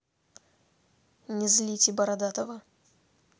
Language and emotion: Russian, angry